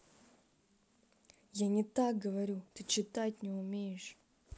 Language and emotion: Russian, angry